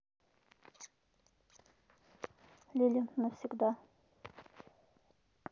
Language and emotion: Russian, neutral